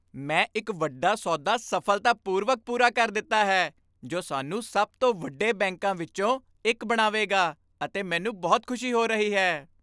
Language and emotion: Punjabi, happy